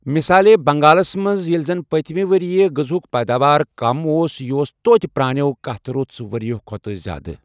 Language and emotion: Kashmiri, neutral